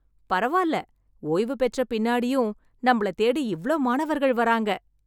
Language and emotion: Tamil, happy